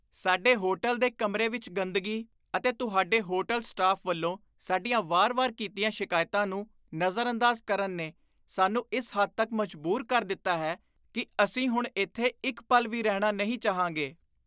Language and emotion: Punjabi, disgusted